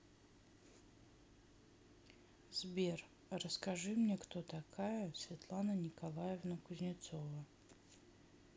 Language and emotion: Russian, neutral